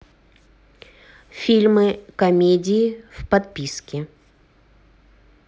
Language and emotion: Russian, neutral